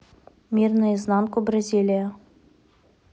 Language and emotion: Russian, neutral